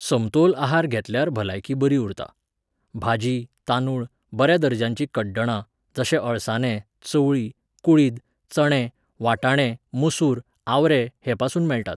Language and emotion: Goan Konkani, neutral